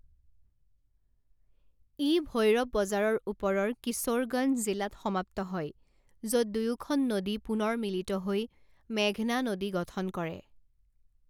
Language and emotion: Assamese, neutral